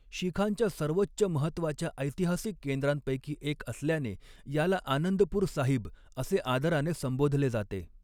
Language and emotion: Marathi, neutral